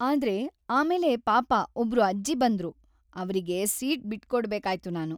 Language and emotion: Kannada, sad